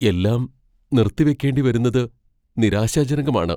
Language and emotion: Malayalam, fearful